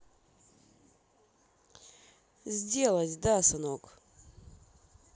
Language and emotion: Russian, neutral